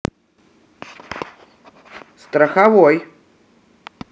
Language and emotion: Russian, positive